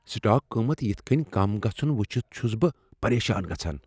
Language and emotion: Kashmiri, fearful